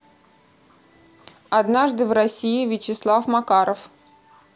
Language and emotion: Russian, neutral